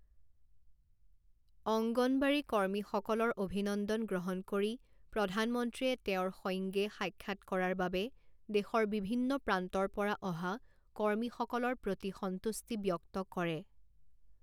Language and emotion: Assamese, neutral